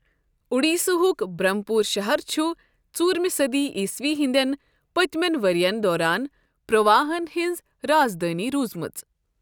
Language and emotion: Kashmiri, neutral